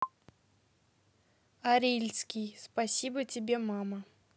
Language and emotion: Russian, neutral